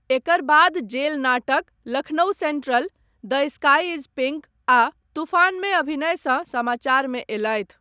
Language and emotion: Maithili, neutral